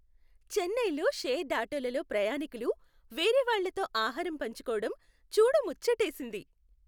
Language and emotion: Telugu, happy